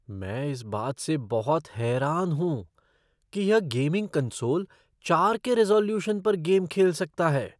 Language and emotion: Hindi, surprised